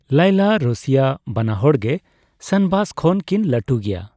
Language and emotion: Santali, neutral